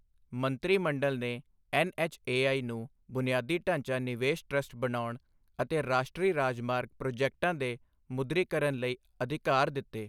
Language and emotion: Punjabi, neutral